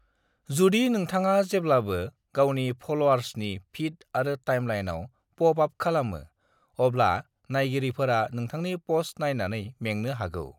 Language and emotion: Bodo, neutral